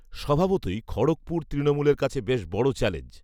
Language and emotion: Bengali, neutral